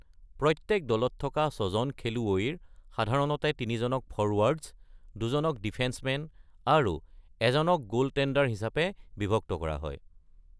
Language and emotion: Assamese, neutral